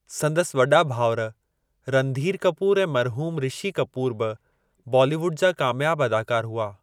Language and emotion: Sindhi, neutral